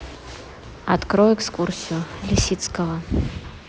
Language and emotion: Russian, neutral